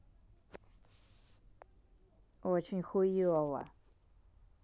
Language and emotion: Russian, angry